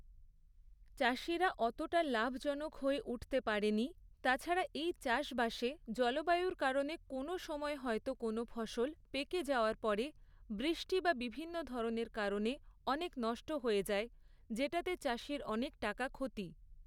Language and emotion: Bengali, neutral